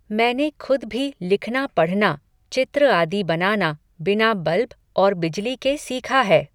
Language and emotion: Hindi, neutral